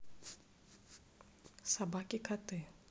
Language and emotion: Russian, neutral